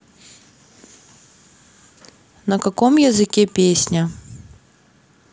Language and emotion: Russian, neutral